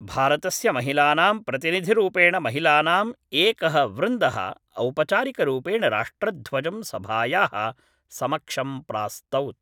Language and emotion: Sanskrit, neutral